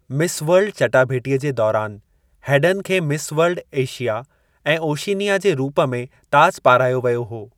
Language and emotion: Sindhi, neutral